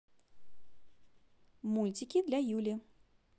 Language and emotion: Russian, positive